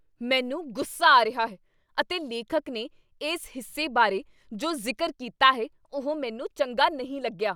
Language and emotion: Punjabi, angry